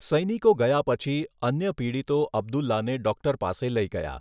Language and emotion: Gujarati, neutral